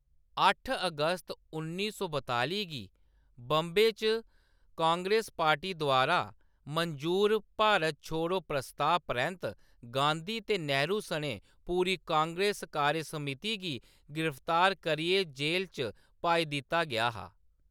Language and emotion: Dogri, neutral